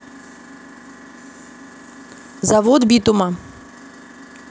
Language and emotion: Russian, neutral